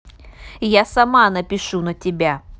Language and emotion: Russian, angry